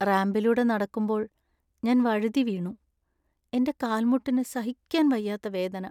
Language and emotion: Malayalam, sad